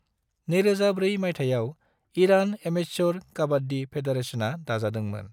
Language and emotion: Bodo, neutral